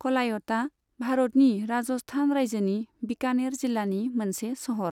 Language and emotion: Bodo, neutral